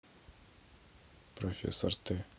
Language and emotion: Russian, neutral